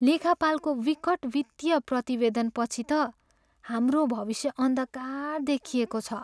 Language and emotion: Nepali, sad